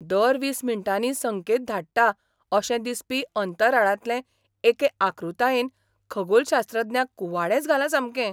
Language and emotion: Goan Konkani, surprised